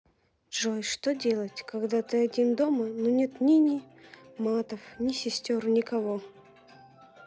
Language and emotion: Russian, sad